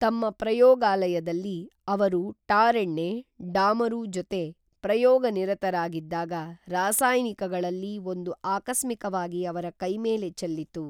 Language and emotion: Kannada, neutral